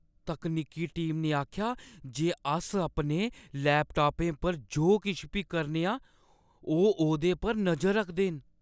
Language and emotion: Dogri, fearful